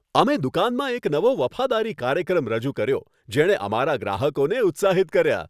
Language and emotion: Gujarati, happy